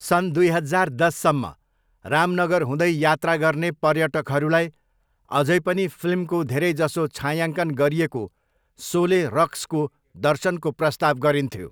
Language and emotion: Nepali, neutral